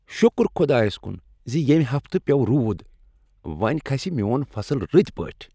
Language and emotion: Kashmiri, happy